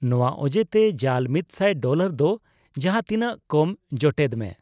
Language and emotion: Santali, neutral